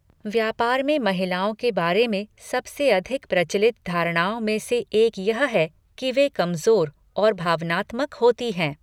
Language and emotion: Hindi, neutral